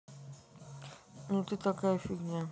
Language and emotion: Russian, neutral